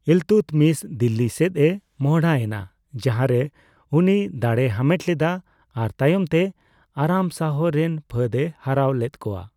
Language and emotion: Santali, neutral